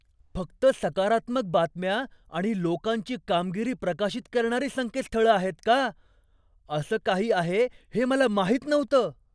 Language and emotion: Marathi, surprised